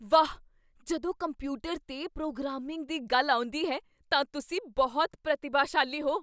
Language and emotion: Punjabi, surprised